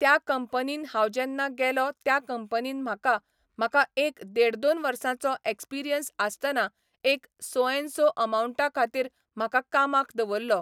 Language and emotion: Goan Konkani, neutral